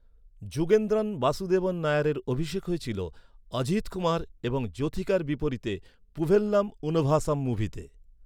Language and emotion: Bengali, neutral